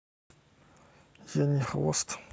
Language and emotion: Russian, neutral